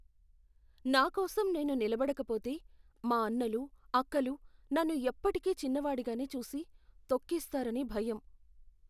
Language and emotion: Telugu, fearful